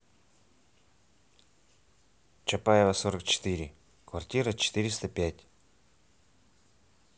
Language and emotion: Russian, neutral